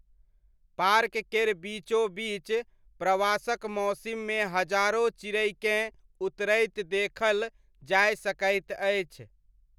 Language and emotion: Maithili, neutral